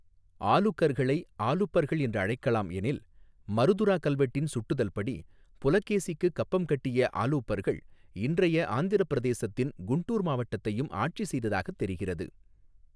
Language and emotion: Tamil, neutral